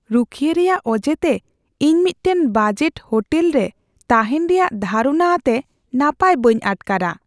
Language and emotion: Santali, fearful